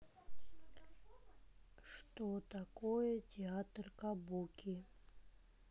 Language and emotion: Russian, neutral